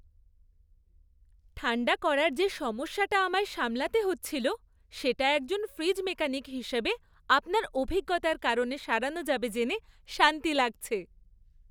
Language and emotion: Bengali, happy